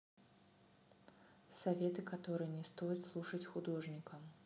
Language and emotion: Russian, neutral